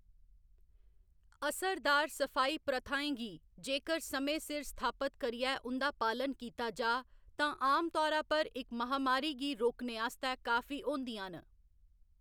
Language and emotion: Dogri, neutral